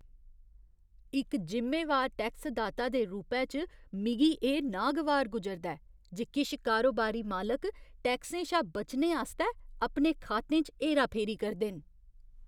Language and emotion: Dogri, disgusted